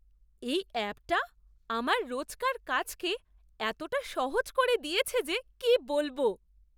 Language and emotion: Bengali, surprised